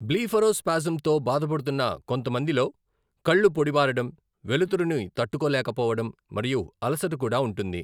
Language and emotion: Telugu, neutral